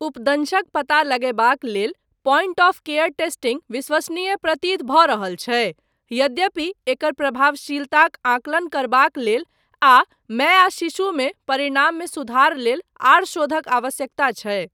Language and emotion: Maithili, neutral